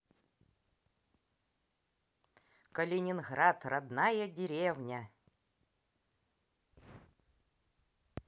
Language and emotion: Russian, positive